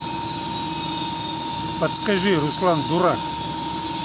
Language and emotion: Russian, neutral